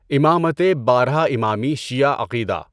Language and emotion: Urdu, neutral